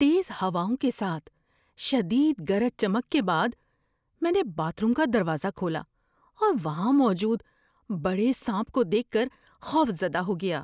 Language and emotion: Urdu, fearful